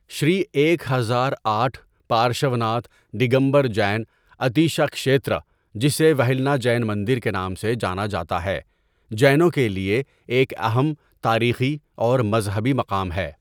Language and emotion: Urdu, neutral